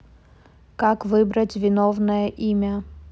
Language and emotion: Russian, neutral